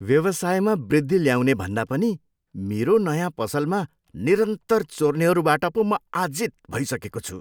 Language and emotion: Nepali, disgusted